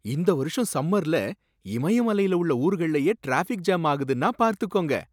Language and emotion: Tamil, surprised